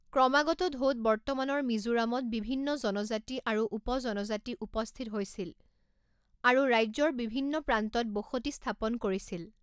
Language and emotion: Assamese, neutral